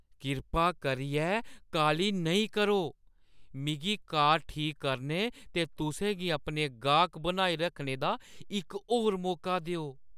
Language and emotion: Dogri, fearful